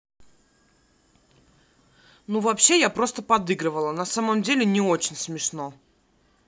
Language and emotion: Russian, angry